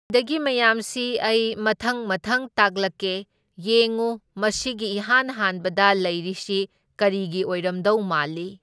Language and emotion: Manipuri, neutral